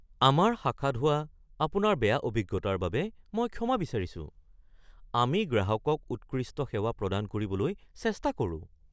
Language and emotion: Assamese, surprised